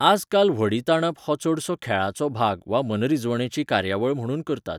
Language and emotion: Goan Konkani, neutral